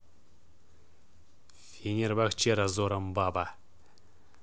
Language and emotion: Russian, neutral